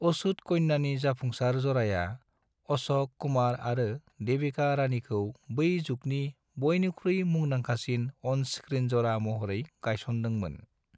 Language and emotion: Bodo, neutral